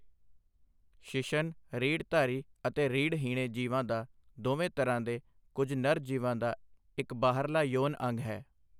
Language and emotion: Punjabi, neutral